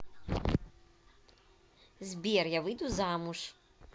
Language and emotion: Russian, neutral